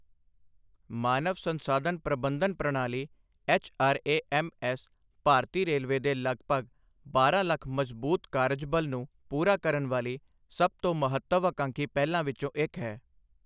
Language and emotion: Punjabi, neutral